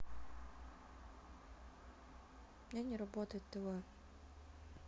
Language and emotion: Russian, sad